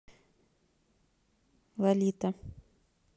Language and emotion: Russian, neutral